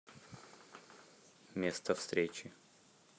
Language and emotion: Russian, neutral